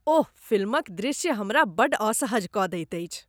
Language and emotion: Maithili, disgusted